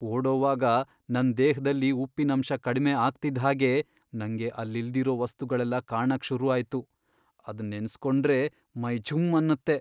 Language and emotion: Kannada, fearful